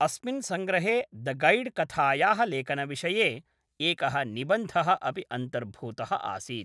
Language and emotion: Sanskrit, neutral